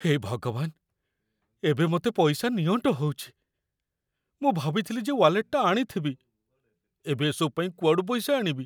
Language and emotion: Odia, fearful